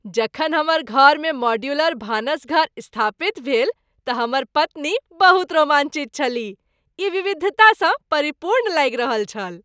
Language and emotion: Maithili, happy